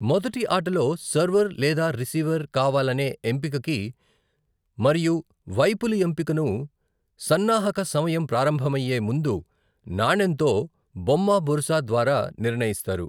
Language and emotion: Telugu, neutral